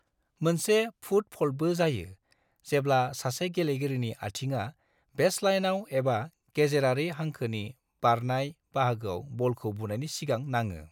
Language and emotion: Bodo, neutral